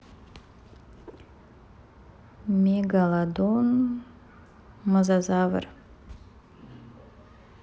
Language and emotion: Russian, neutral